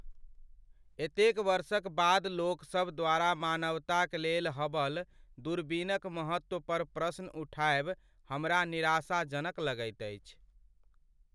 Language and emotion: Maithili, sad